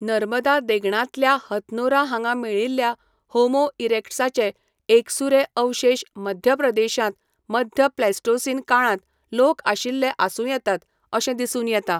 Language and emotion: Goan Konkani, neutral